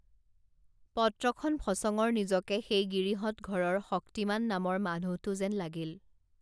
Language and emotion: Assamese, neutral